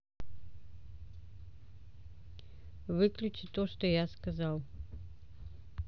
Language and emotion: Russian, neutral